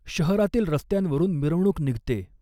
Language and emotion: Marathi, neutral